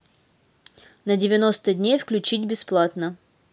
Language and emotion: Russian, neutral